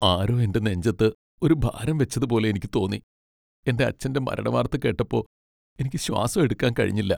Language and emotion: Malayalam, sad